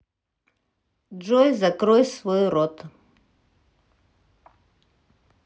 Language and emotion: Russian, neutral